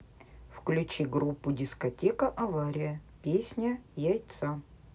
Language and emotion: Russian, neutral